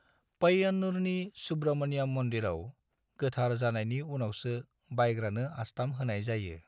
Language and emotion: Bodo, neutral